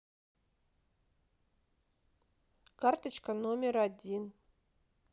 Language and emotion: Russian, neutral